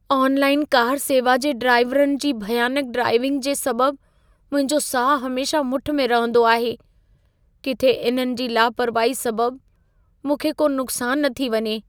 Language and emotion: Sindhi, fearful